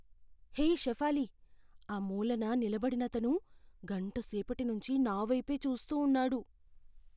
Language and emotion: Telugu, fearful